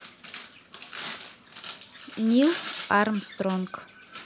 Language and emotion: Russian, neutral